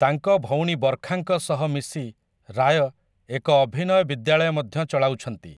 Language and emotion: Odia, neutral